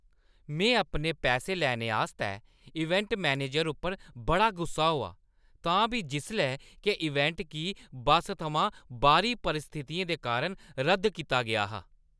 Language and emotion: Dogri, angry